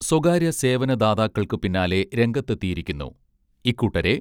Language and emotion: Malayalam, neutral